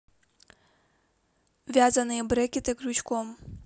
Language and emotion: Russian, neutral